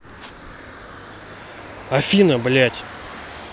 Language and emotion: Russian, angry